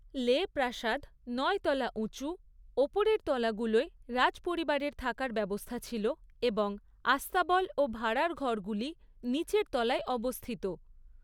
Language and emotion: Bengali, neutral